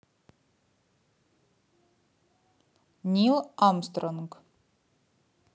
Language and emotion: Russian, neutral